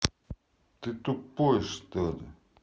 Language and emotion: Russian, angry